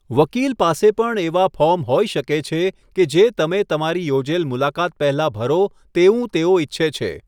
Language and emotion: Gujarati, neutral